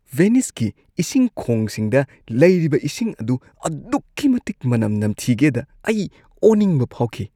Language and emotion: Manipuri, disgusted